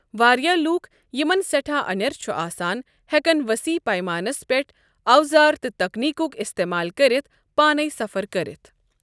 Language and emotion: Kashmiri, neutral